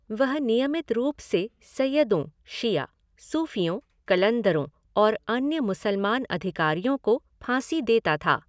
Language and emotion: Hindi, neutral